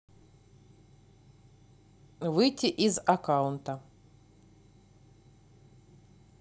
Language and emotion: Russian, neutral